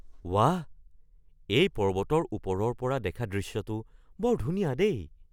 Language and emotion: Assamese, surprised